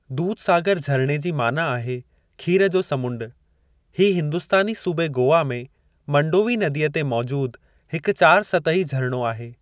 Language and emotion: Sindhi, neutral